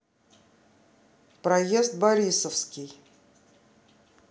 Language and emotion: Russian, neutral